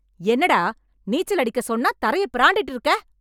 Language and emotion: Tamil, angry